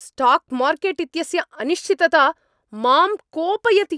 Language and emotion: Sanskrit, angry